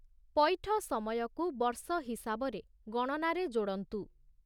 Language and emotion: Odia, neutral